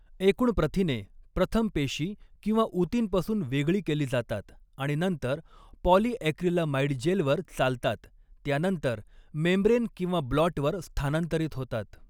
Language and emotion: Marathi, neutral